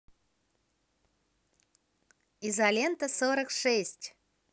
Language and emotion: Russian, positive